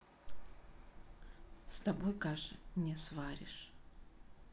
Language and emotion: Russian, sad